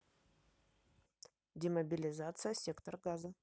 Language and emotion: Russian, neutral